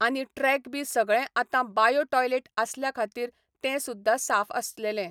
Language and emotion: Goan Konkani, neutral